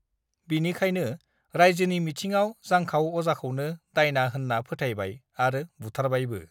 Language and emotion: Bodo, neutral